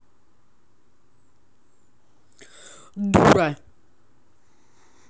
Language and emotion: Russian, angry